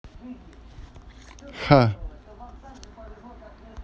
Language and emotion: Russian, neutral